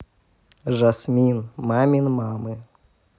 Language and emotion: Russian, positive